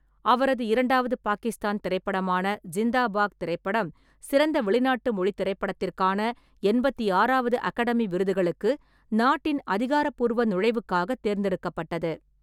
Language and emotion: Tamil, neutral